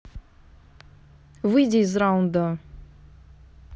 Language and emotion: Russian, angry